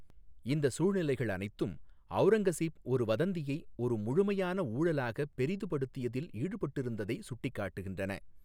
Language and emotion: Tamil, neutral